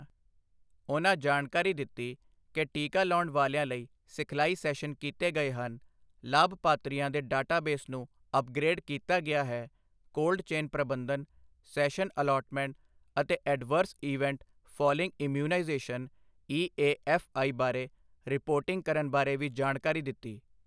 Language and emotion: Punjabi, neutral